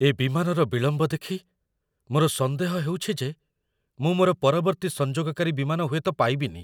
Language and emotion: Odia, fearful